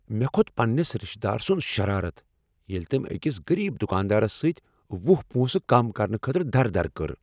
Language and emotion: Kashmiri, angry